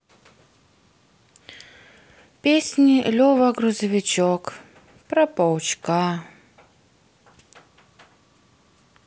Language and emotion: Russian, sad